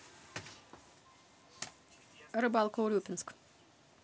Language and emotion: Russian, neutral